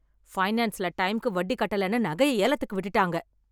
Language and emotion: Tamil, angry